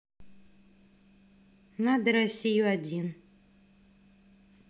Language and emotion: Russian, neutral